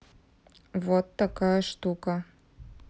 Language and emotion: Russian, neutral